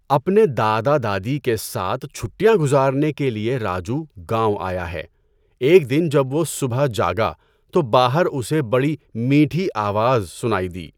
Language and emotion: Urdu, neutral